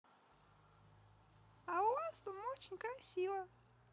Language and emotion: Russian, neutral